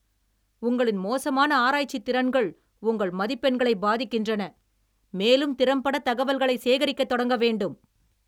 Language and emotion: Tamil, angry